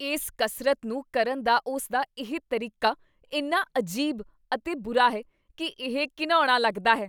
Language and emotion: Punjabi, disgusted